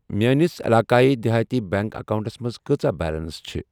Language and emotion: Kashmiri, neutral